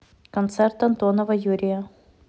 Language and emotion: Russian, neutral